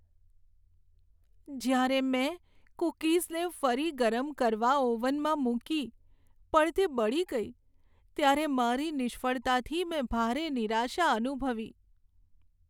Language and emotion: Gujarati, sad